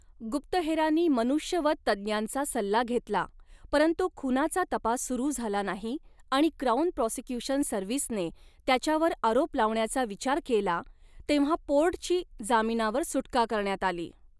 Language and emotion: Marathi, neutral